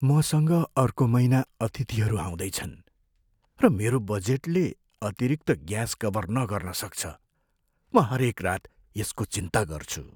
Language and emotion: Nepali, fearful